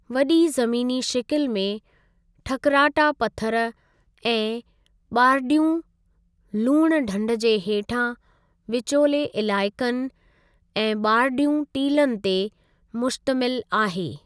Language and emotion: Sindhi, neutral